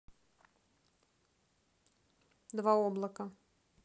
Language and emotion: Russian, neutral